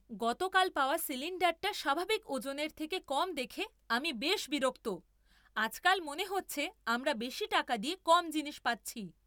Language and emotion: Bengali, angry